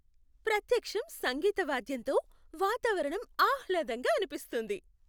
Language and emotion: Telugu, happy